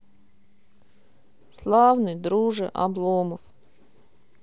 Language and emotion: Russian, sad